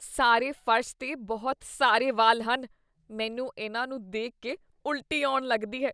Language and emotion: Punjabi, disgusted